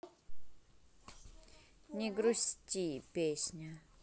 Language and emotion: Russian, neutral